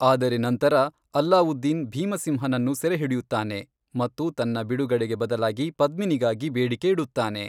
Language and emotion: Kannada, neutral